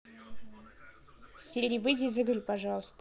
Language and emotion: Russian, neutral